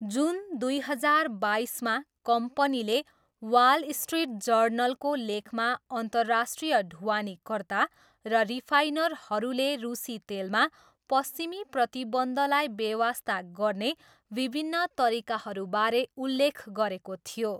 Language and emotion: Nepali, neutral